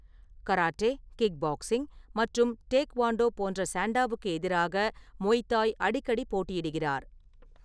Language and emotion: Tamil, neutral